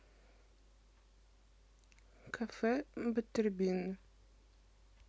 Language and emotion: Russian, neutral